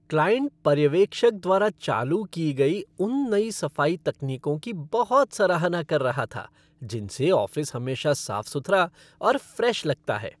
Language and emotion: Hindi, happy